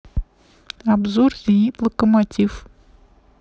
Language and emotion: Russian, neutral